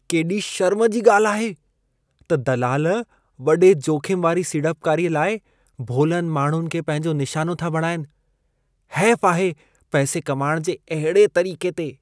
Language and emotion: Sindhi, disgusted